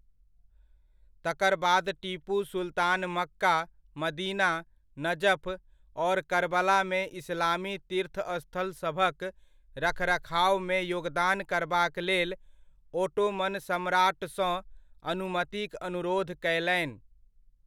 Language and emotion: Maithili, neutral